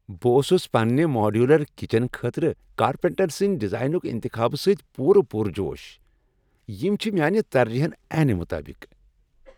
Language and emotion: Kashmiri, happy